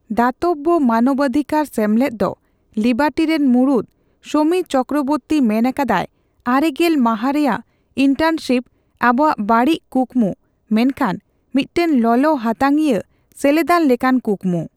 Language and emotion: Santali, neutral